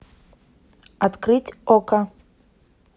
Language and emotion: Russian, neutral